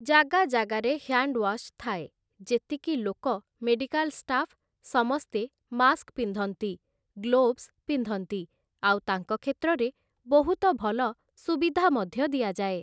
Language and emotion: Odia, neutral